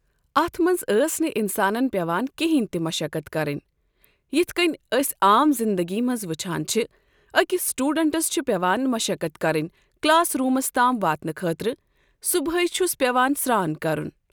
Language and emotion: Kashmiri, neutral